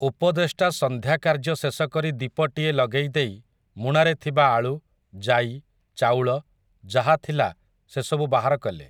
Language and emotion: Odia, neutral